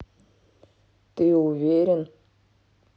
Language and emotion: Russian, neutral